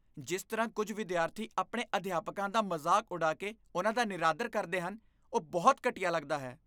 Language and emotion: Punjabi, disgusted